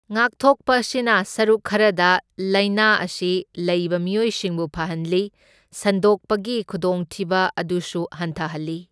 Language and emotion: Manipuri, neutral